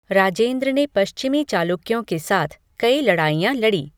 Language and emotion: Hindi, neutral